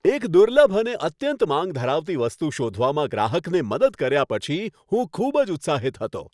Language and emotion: Gujarati, happy